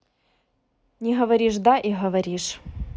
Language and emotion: Russian, neutral